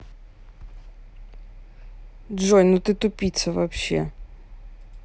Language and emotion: Russian, angry